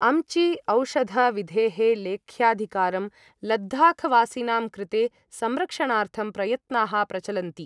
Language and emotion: Sanskrit, neutral